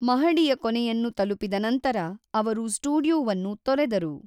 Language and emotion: Kannada, neutral